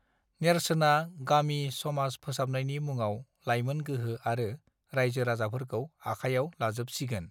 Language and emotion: Bodo, neutral